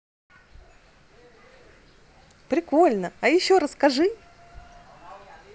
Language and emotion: Russian, positive